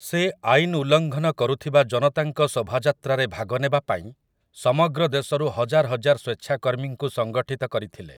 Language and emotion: Odia, neutral